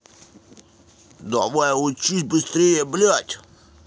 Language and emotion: Russian, angry